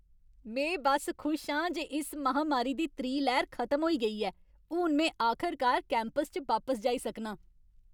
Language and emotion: Dogri, happy